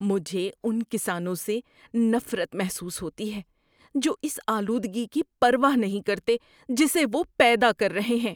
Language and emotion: Urdu, disgusted